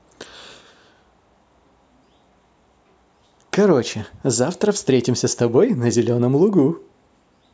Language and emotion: Russian, positive